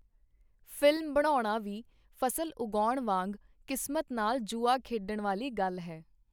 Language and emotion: Punjabi, neutral